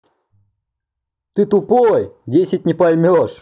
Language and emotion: Russian, angry